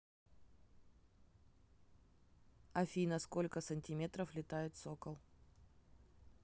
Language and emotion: Russian, neutral